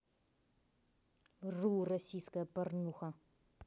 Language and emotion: Russian, angry